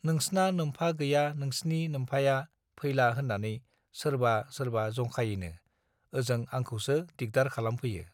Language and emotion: Bodo, neutral